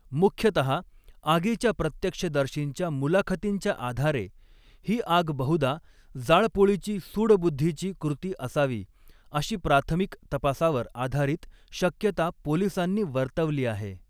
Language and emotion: Marathi, neutral